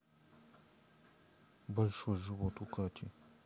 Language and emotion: Russian, neutral